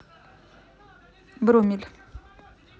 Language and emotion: Russian, neutral